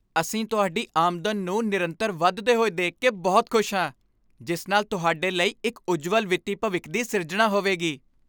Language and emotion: Punjabi, happy